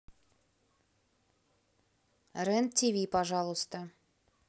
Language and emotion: Russian, neutral